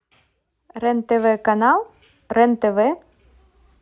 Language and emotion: Russian, neutral